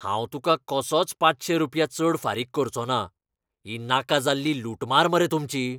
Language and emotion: Goan Konkani, angry